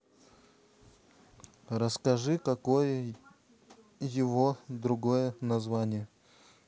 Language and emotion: Russian, neutral